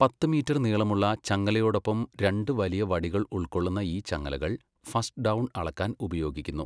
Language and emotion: Malayalam, neutral